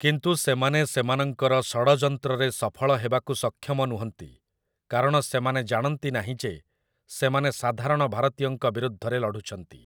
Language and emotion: Odia, neutral